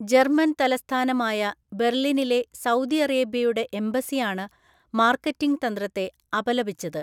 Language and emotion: Malayalam, neutral